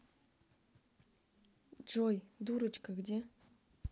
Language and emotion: Russian, neutral